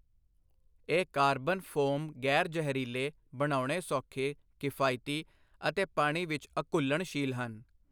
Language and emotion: Punjabi, neutral